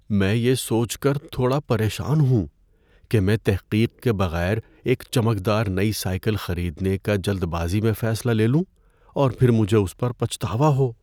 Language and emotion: Urdu, fearful